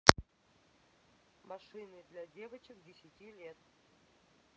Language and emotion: Russian, neutral